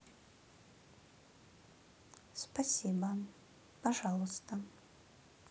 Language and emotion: Russian, neutral